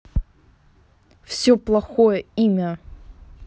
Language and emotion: Russian, angry